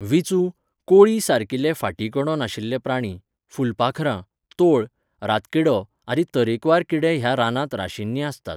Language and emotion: Goan Konkani, neutral